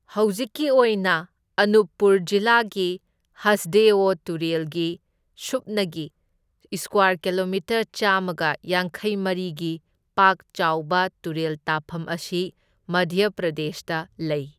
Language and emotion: Manipuri, neutral